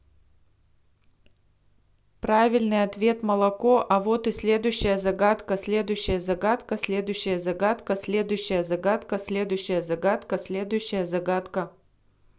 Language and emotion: Russian, neutral